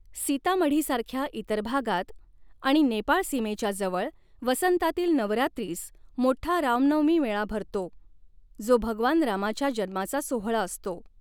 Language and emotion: Marathi, neutral